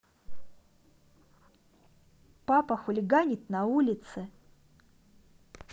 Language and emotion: Russian, neutral